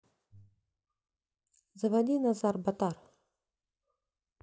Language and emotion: Russian, neutral